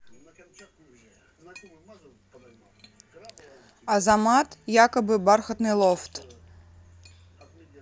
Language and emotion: Russian, neutral